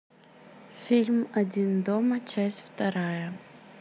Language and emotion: Russian, neutral